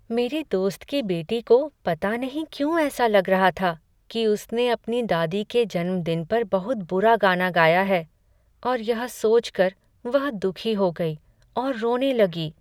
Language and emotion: Hindi, sad